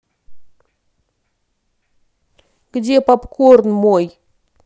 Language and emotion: Russian, angry